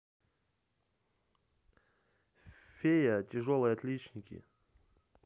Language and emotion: Russian, neutral